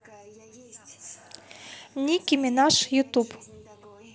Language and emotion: Russian, neutral